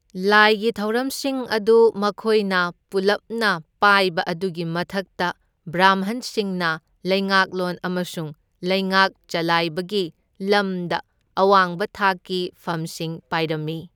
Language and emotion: Manipuri, neutral